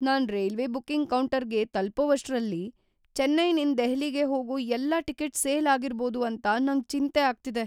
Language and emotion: Kannada, fearful